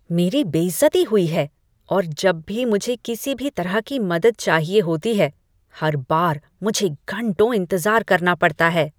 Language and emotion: Hindi, disgusted